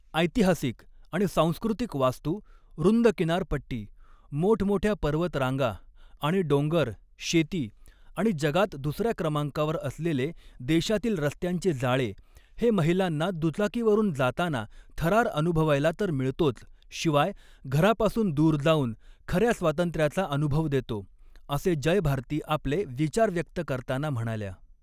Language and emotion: Marathi, neutral